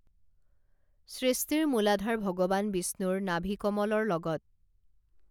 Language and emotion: Assamese, neutral